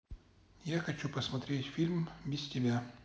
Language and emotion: Russian, neutral